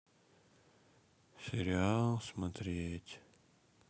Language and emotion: Russian, sad